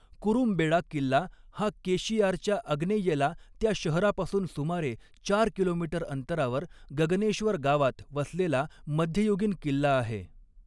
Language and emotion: Marathi, neutral